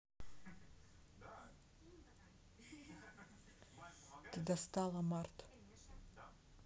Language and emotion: Russian, neutral